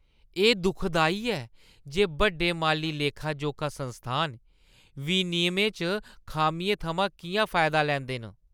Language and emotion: Dogri, disgusted